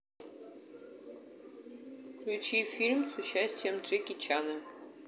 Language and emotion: Russian, neutral